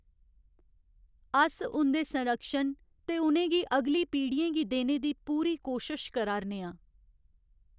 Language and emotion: Dogri, sad